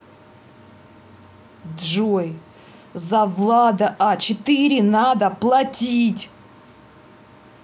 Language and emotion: Russian, angry